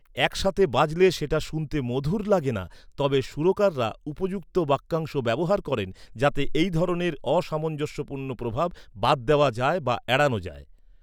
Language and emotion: Bengali, neutral